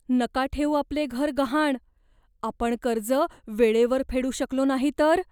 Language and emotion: Marathi, fearful